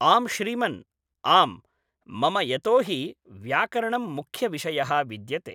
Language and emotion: Sanskrit, neutral